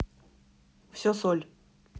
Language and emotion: Russian, neutral